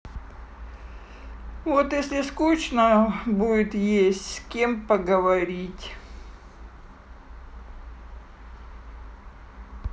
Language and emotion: Russian, sad